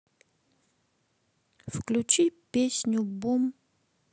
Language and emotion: Russian, neutral